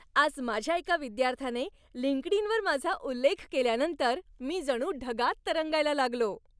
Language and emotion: Marathi, happy